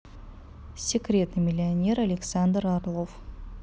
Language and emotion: Russian, neutral